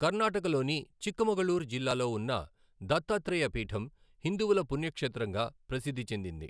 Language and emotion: Telugu, neutral